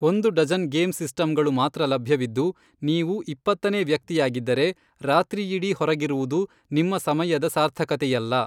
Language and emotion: Kannada, neutral